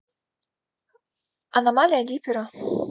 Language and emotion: Russian, neutral